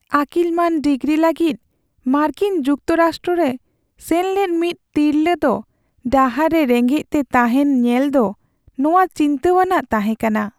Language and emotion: Santali, sad